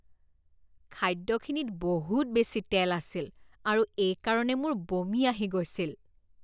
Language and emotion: Assamese, disgusted